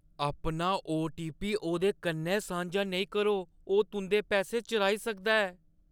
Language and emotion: Dogri, fearful